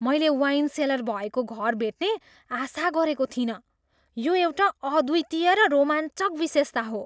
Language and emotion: Nepali, surprised